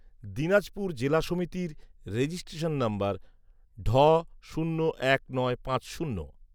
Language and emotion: Bengali, neutral